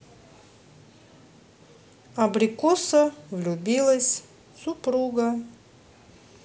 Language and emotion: Russian, neutral